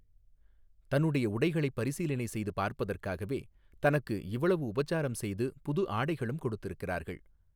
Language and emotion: Tamil, neutral